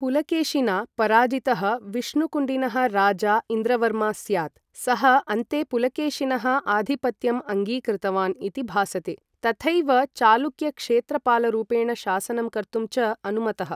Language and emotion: Sanskrit, neutral